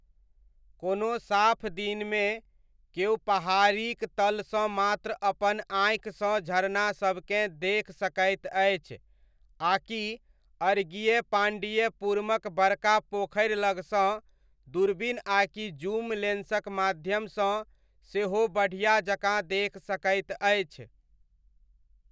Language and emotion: Maithili, neutral